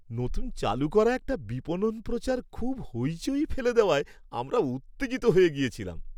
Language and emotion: Bengali, happy